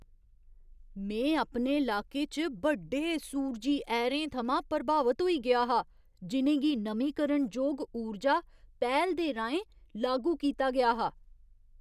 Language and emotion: Dogri, surprised